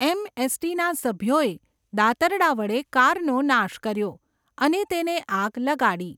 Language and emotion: Gujarati, neutral